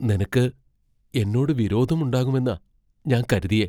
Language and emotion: Malayalam, fearful